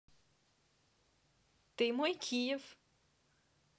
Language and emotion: Russian, positive